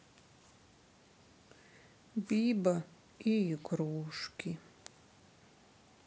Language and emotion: Russian, sad